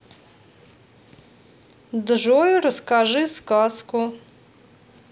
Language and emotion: Russian, neutral